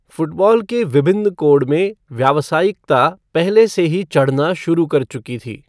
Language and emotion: Hindi, neutral